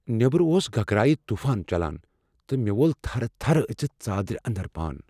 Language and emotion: Kashmiri, fearful